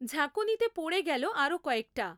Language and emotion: Bengali, neutral